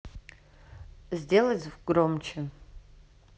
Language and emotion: Russian, neutral